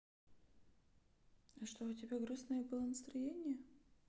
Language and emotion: Russian, sad